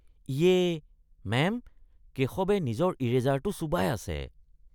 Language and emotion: Assamese, disgusted